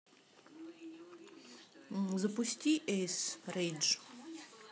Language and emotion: Russian, neutral